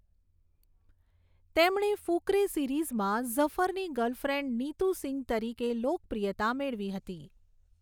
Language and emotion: Gujarati, neutral